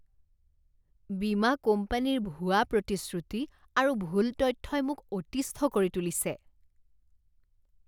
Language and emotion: Assamese, disgusted